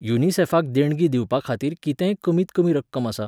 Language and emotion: Goan Konkani, neutral